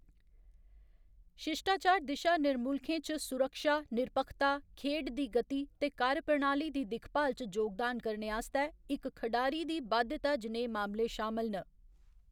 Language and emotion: Dogri, neutral